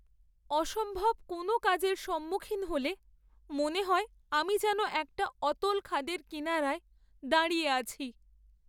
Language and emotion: Bengali, sad